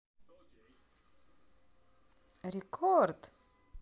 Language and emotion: Russian, positive